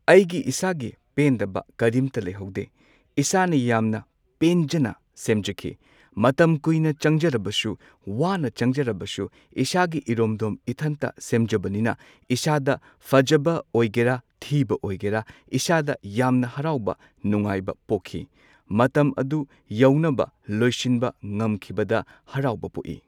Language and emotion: Manipuri, neutral